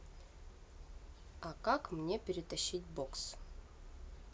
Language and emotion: Russian, neutral